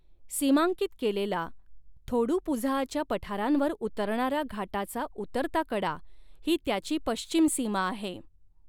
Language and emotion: Marathi, neutral